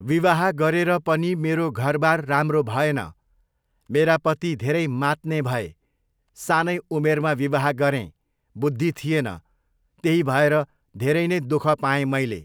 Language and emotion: Nepali, neutral